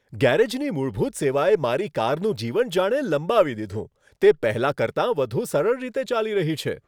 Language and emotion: Gujarati, happy